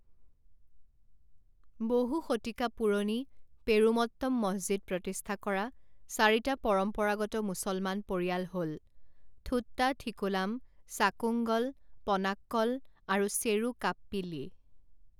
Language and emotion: Assamese, neutral